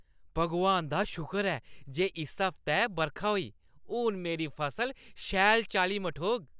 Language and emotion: Dogri, happy